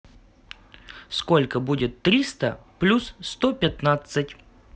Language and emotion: Russian, positive